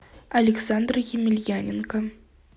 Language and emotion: Russian, neutral